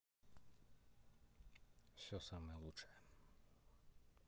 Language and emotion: Russian, neutral